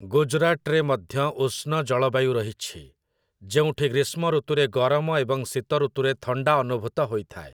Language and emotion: Odia, neutral